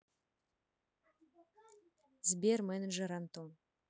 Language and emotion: Russian, neutral